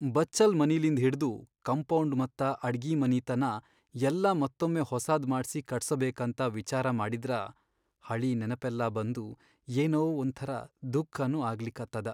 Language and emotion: Kannada, sad